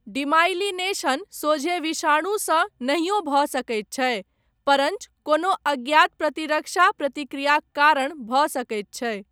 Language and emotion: Maithili, neutral